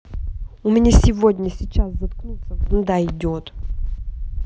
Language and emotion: Russian, angry